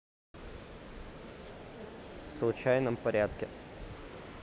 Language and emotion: Russian, neutral